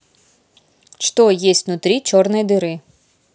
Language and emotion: Russian, neutral